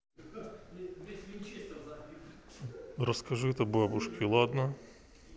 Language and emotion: Russian, neutral